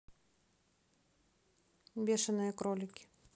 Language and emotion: Russian, neutral